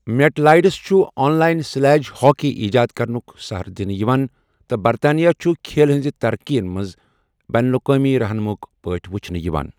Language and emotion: Kashmiri, neutral